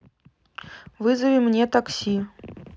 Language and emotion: Russian, neutral